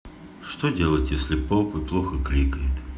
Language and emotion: Russian, neutral